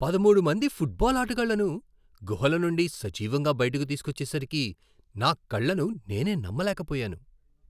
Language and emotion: Telugu, surprised